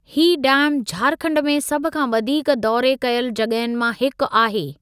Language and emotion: Sindhi, neutral